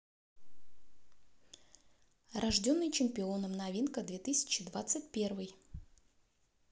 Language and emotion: Russian, neutral